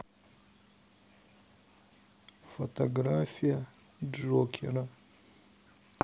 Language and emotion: Russian, sad